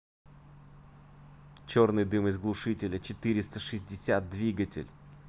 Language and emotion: Russian, angry